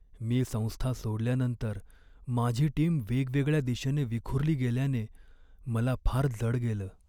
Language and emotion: Marathi, sad